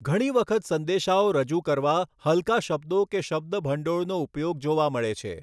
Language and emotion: Gujarati, neutral